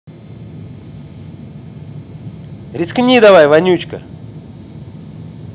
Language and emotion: Russian, angry